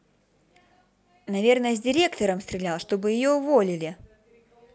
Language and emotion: Russian, positive